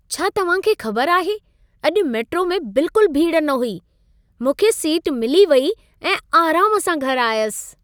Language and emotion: Sindhi, happy